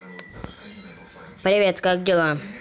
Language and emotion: Russian, neutral